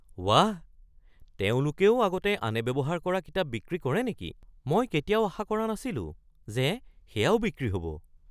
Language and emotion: Assamese, surprised